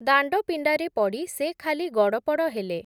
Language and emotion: Odia, neutral